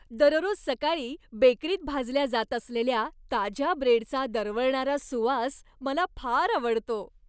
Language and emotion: Marathi, happy